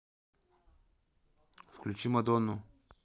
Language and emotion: Russian, neutral